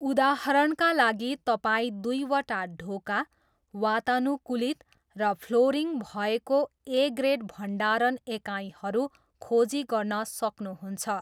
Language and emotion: Nepali, neutral